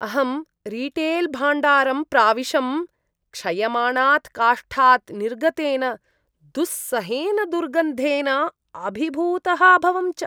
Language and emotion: Sanskrit, disgusted